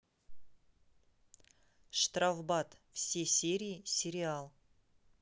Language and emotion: Russian, neutral